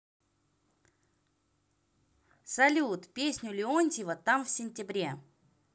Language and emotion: Russian, positive